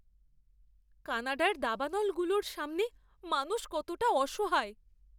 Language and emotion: Bengali, fearful